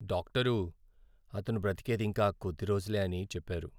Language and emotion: Telugu, sad